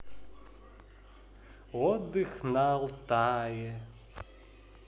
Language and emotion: Russian, positive